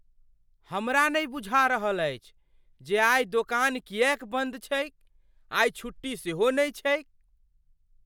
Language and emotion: Maithili, surprised